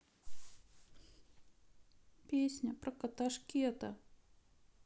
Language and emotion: Russian, sad